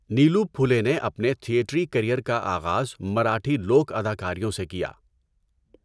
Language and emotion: Urdu, neutral